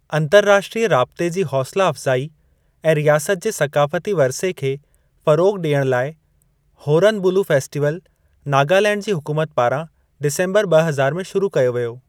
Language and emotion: Sindhi, neutral